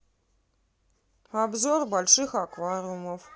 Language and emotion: Russian, neutral